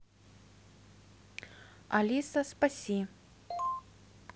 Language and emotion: Russian, neutral